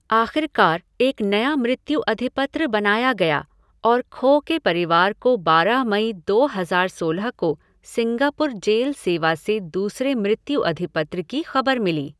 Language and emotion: Hindi, neutral